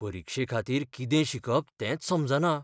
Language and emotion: Goan Konkani, fearful